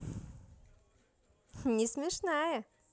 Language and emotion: Russian, positive